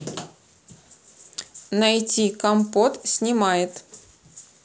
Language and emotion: Russian, neutral